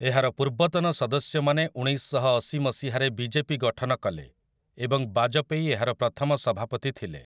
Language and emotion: Odia, neutral